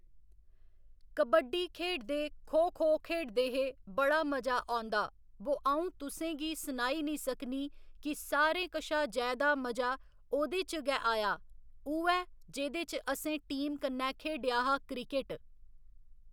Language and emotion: Dogri, neutral